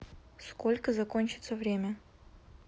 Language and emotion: Russian, neutral